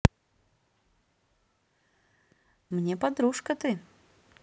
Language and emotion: Russian, positive